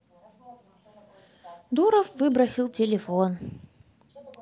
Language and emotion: Russian, neutral